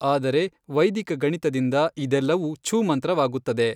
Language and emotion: Kannada, neutral